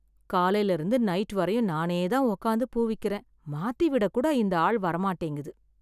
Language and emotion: Tamil, sad